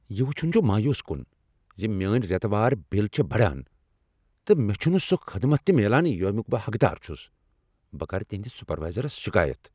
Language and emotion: Kashmiri, angry